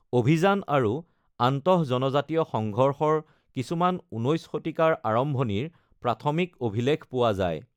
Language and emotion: Assamese, neutral